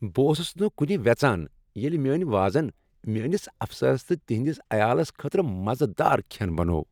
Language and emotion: Kashmiri, happy